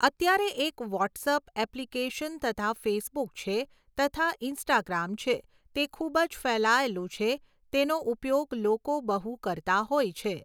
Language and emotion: Gujarati, neutral